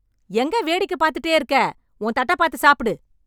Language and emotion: Tamil, angry